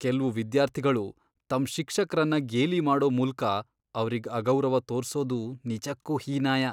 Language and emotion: Kannada, disgusted